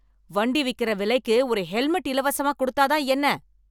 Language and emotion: Tamil, angry